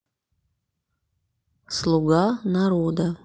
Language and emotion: Russian, neutral